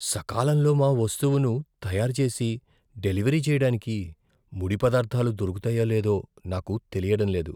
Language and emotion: Telugu, fearful